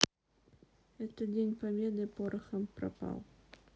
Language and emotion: Russian, sad